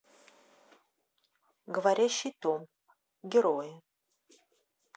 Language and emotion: Russian, neutral